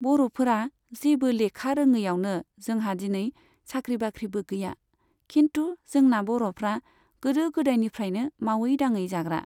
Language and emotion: Bodo, neutral